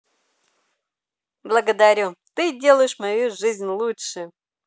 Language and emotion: Russian, positive